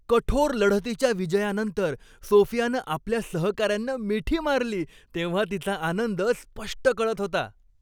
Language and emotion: Marathi, happy